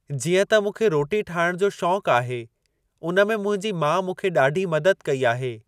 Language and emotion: Sindhi, neutral